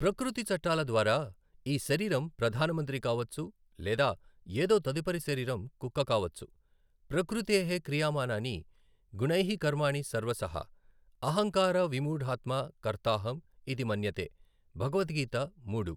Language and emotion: Telugu, neutral